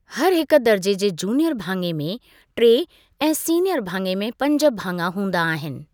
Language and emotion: Sindhi, neutral